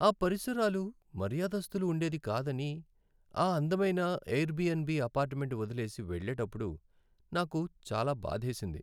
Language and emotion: Telugu, sad